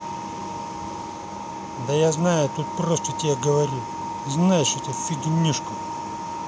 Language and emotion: Russian, angry